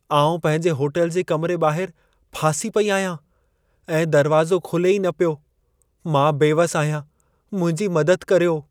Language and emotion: Sindhi, sad